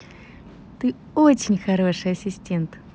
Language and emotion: Russian, positive